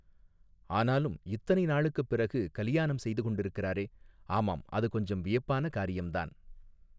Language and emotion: Tamil, neutral